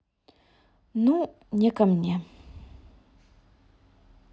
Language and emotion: Russian, sad